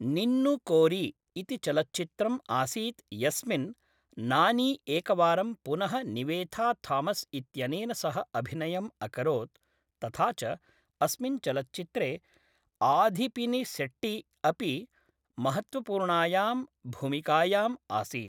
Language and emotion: Sanskrit, neutral